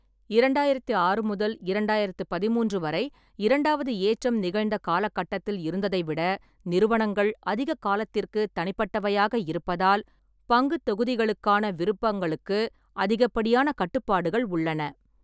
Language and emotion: Tamil, neutral